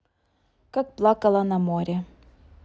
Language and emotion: Russian, neutral